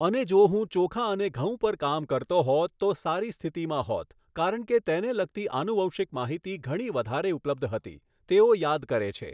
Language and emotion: Gujarati, neutral